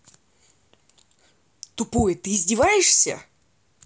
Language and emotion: Russian, angry